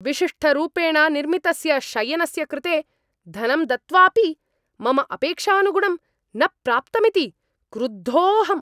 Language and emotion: Sanskrit, angry